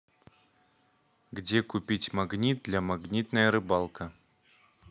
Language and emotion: Russian, neutral